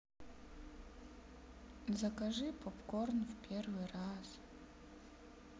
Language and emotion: Russian, sad